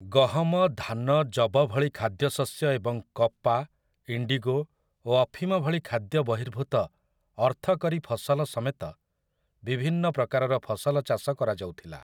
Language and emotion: Odia, neutral